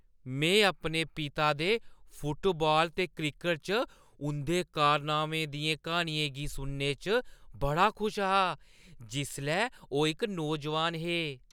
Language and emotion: Dogri, happy